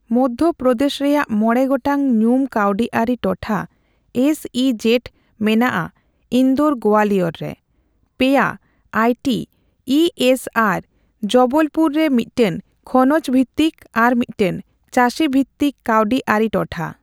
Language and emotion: Santali, neutral